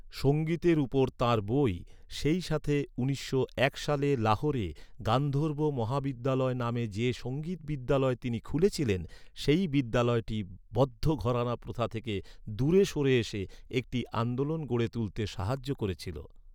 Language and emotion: Bengali, neutral